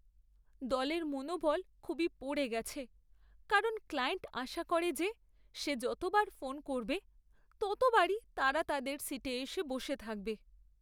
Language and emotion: Bengali, sad